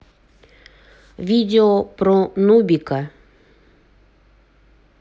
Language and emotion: Russian, neutral